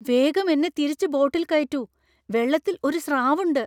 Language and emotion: Malayalam, fearful